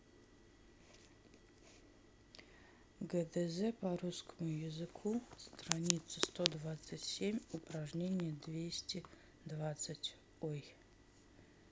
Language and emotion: Russian, neutral